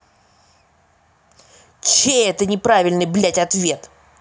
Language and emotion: Russian, angry